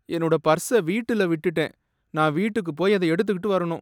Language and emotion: Tamil, sad